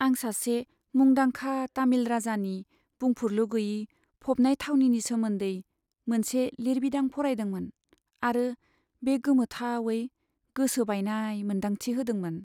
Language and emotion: Bodo, sad